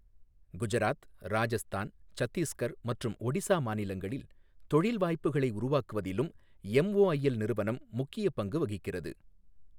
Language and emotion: Tamil, neutral